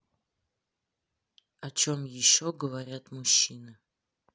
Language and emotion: Russian, neutral